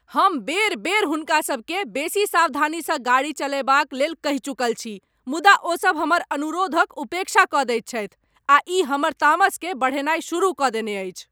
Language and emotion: Maithili, angry